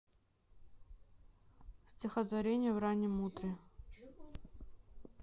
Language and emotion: Russian, neutral